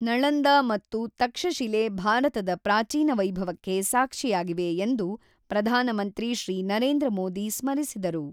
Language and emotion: Kannada, neutral